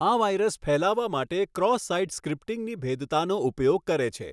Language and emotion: Gujarati, neutral